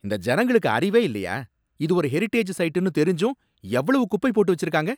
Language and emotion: Tamil, angry